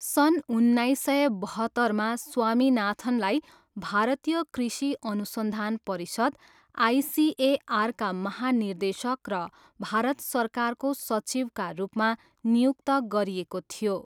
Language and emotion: Nepali, neutral